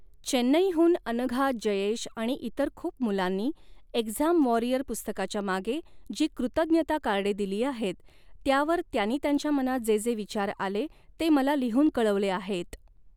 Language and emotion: Marathi, neutral